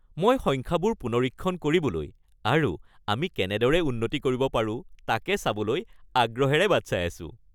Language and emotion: Assamese, happy